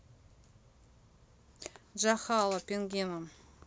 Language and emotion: Russian, neutral